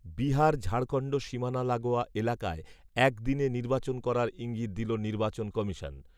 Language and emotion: Bengali, neutral